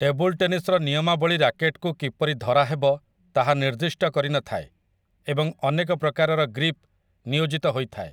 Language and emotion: Odia, neutral